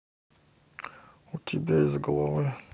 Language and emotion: Russian, neutral